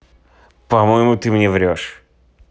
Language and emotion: Russian, neutral